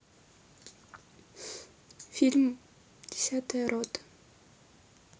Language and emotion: Russian, sad